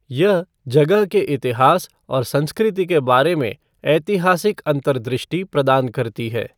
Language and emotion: Hindi, neutral